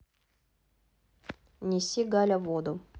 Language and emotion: Russian, neutral